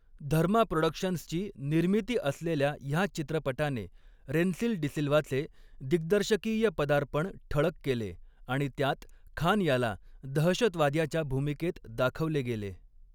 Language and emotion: Marathi, neutral